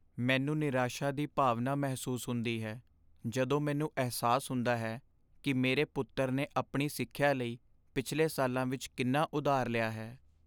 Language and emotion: Punjabi, sad